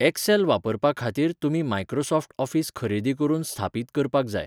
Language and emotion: Goan Konkani, neutral